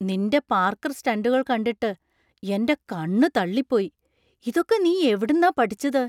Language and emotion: Malayalam, surprised